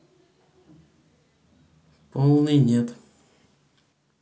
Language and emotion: Russian, neutral